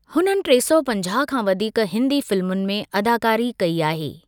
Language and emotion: Sindhi, neutral